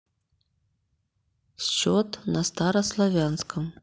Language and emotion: Russian, neutral